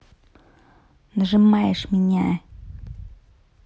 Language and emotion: Russian, neutral